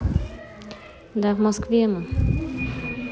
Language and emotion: Russian, neutral